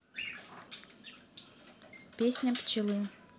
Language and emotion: Russian, neutral